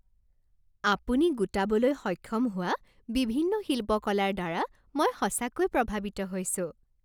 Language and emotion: Assamese, happy